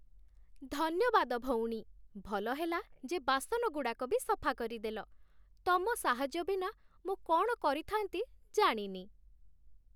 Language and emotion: Odia, happy